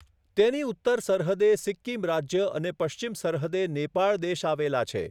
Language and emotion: Gujarati, neutral